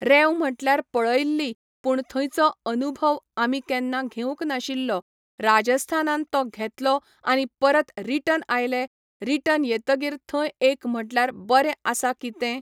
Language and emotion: Goan Konkani, neutral